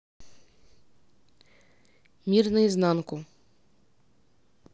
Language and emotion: Russian, neutral